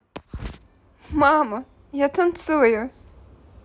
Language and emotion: Russian, positive